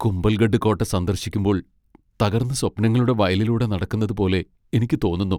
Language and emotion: Malayalam, sad